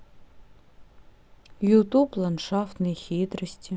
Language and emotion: Russian, sad